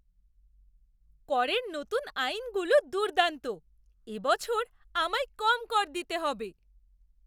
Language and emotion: Bengali, surprised